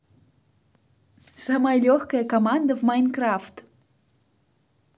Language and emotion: Russian, positive